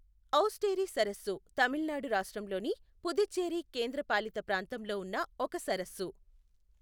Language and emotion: Telugu, neutral